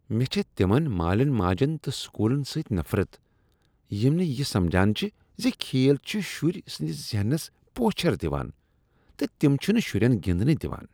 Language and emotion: Kashmiri, disgusted